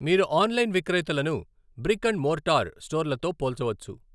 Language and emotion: Telugu, neutral